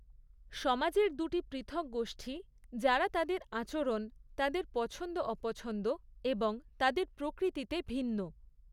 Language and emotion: Bengali, neutral